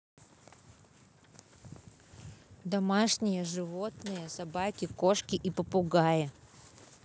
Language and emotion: Russian, positive